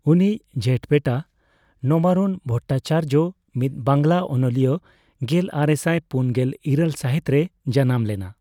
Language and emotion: Santali, neutral